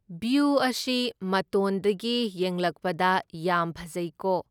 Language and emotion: Manipuri, neutral